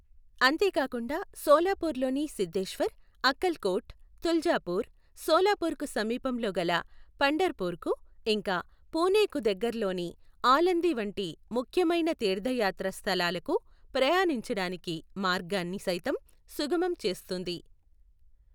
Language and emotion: Telugu, neutral